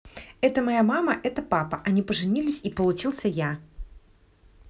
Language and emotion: Russian, positive